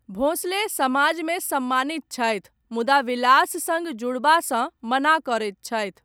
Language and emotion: Maithili, neutral